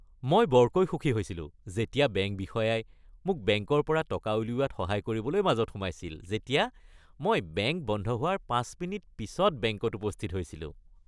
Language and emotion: Assamese, happy